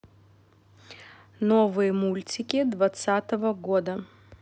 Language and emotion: Russian, neutral